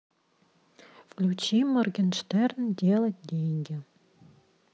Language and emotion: Russian, neutral